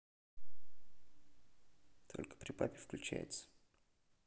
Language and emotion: Russian, neutral